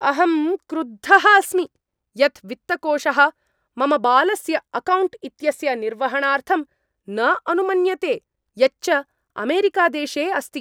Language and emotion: Sanskrit, angry